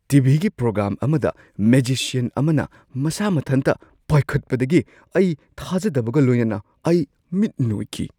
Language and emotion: Manipuri, surprised